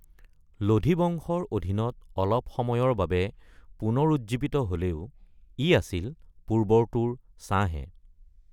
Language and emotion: Assamese, neutral